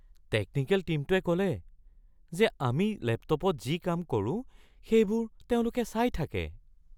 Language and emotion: Assamese, fearful